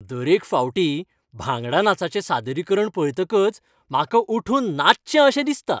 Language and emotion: Goan Konkani, happy